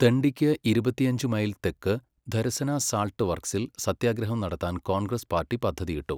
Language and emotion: Malayalam, neutral